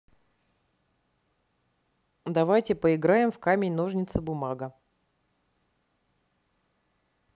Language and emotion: Russian, neutral